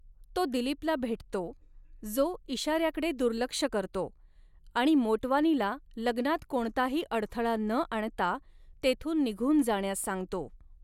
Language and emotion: Marathi, neutral